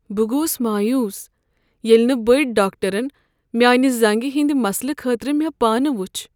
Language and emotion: Kashmiri, sad